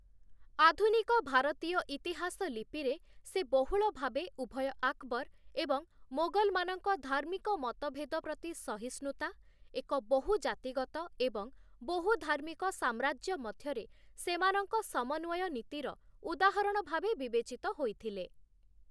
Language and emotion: Odia, neutral